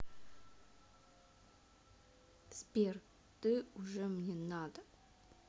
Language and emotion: Russian, neutral